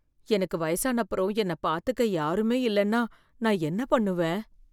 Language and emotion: Tamil, fearful